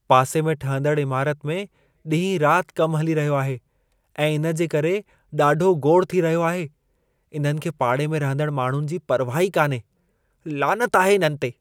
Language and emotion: Sindhi, disgusted